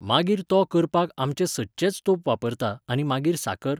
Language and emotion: Goan Konkani, neutral